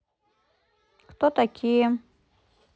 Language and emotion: Russian, neutral